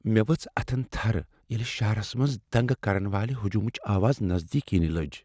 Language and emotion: Kashmiri, fearful